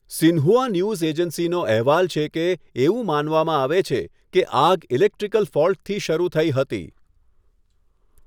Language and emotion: Gujarati, neutral